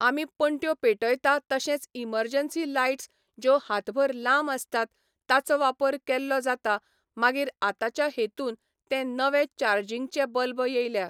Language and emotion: Goan Konkani, neutral